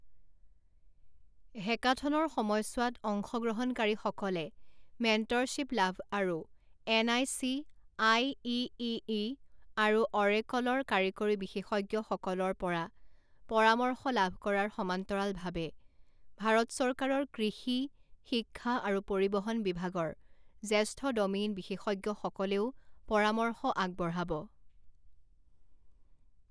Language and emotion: Assamese, neutral